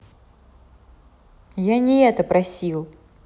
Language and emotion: Russian, neutral